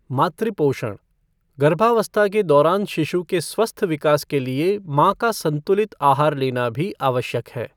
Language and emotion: Hindi, neutral